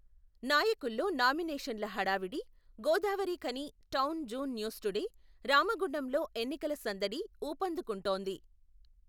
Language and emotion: Telugu, neutral